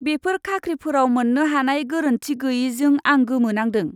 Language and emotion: Bodo, disgusted